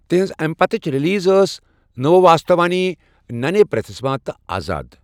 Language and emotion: Kashmiri, neutral